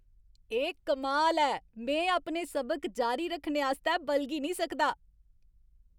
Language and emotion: Dogri, happy